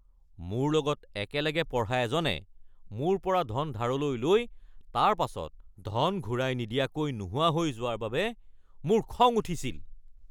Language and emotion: Assamese, angry